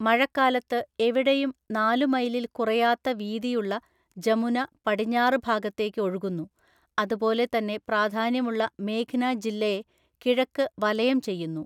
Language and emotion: Malayalam, neutral